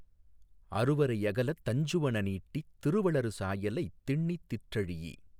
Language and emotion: Tamil, neutral